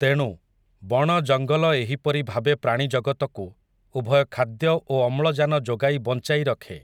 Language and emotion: Odia, neutral